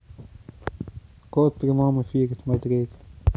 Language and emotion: Russian, neutral